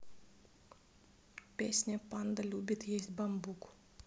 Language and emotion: Russian, neutral